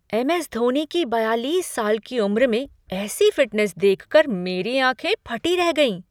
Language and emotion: Hindi, surprised